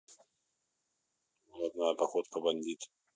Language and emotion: Russian, neutral